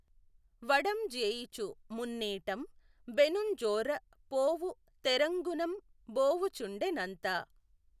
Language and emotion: Telugu, neutral